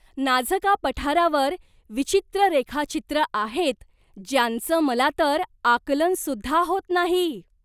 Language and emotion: Marathi, surprised